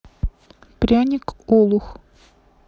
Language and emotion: Russian, neutral